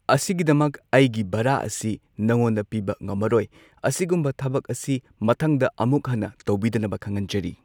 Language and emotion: Manipuri, neutral